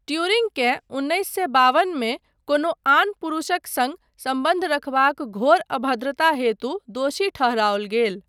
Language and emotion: Maithili, neutral